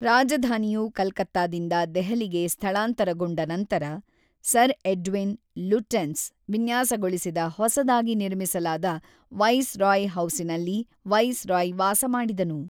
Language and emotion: Kannada, neutral